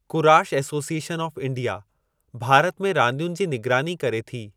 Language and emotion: Sindhi, neutral